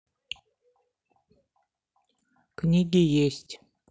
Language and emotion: Russian, neutral